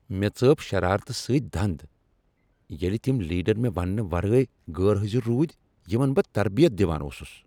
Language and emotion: Kashmiri, angry